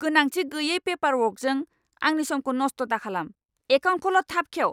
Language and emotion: Bodo, angry